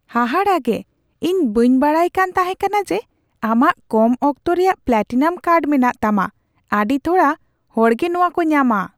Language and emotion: Santali, surprised